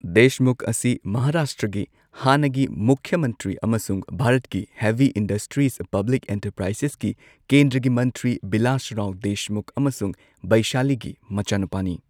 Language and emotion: Manipuri, neutral